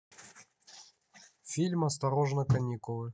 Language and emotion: Russian, neutral